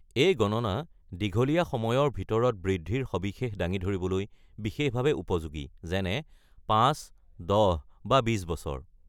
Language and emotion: Assamese, neutral